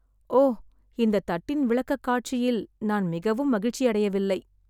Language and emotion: Tamil, sad